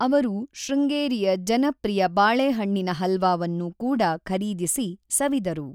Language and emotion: Kannada, neutral